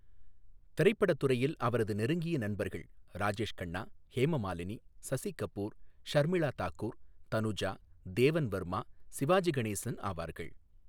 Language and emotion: Tamil, neutral